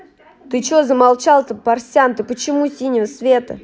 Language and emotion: Russian, angry